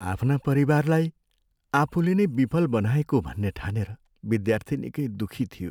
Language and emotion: Nepali, sad